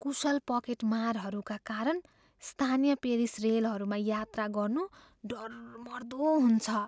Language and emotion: Nepali, fearful